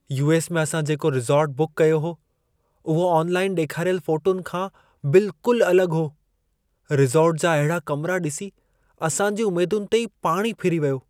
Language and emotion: Sindhi, sad